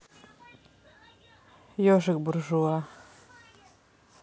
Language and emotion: Russian, neutral